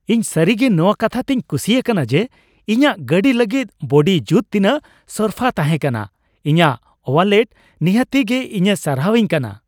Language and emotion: Santali, happy